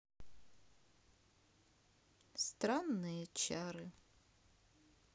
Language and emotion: Russian, sad